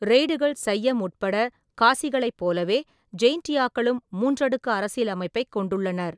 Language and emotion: Tamil, neutral